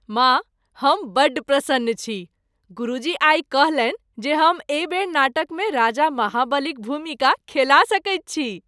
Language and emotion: Maithili, happy